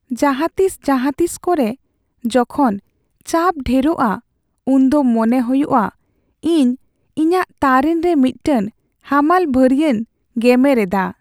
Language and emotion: Santali, sad